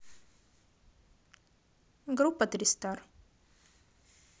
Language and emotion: Russian, neutral